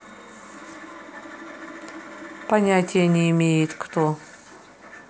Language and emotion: Russian, neutral